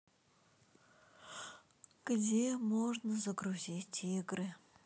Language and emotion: Russian, sad